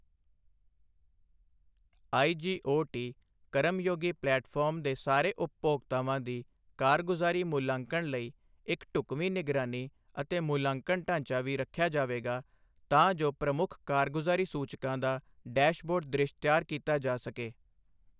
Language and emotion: Punjabi, neutral